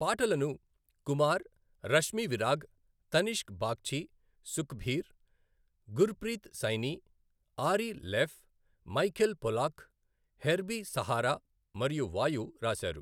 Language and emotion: Telugu, neutral